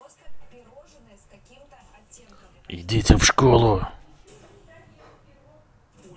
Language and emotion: Russian, angry